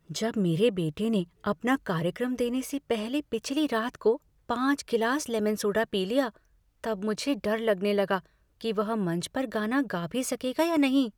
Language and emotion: Hindi, fearful